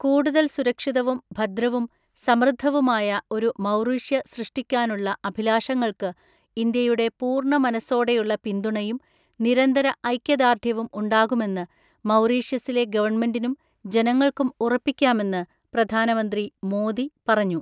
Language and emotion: Malayalam, neutral